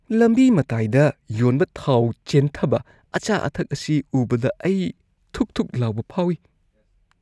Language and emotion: Manipuri, disgusted